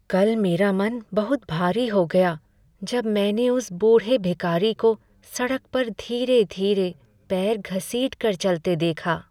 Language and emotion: Hindi, sad